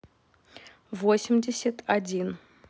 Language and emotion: Russian, neutral